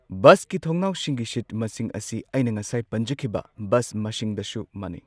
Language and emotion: Manipuri, neutral